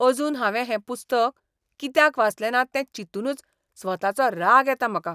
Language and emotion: Goan Konkani, disgusted